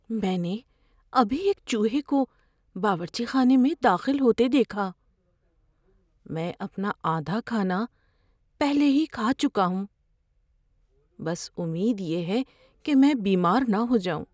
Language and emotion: Urdu, fearful